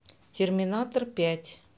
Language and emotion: Russian, neutral